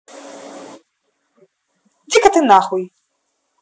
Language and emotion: Russian, angry